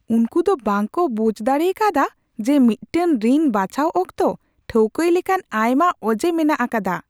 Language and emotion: Santali, surprised